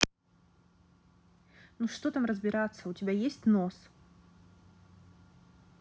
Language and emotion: Russian, angry